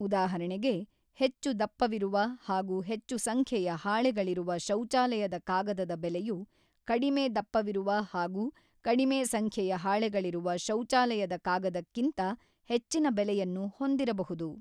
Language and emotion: Kannada, neutral